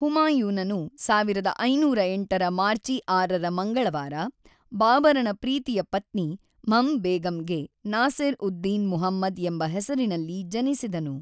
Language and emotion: Kannada, neutral